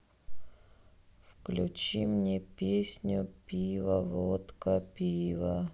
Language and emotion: Russian, sad